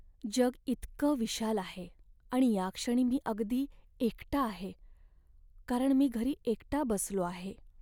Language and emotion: Marathi, sad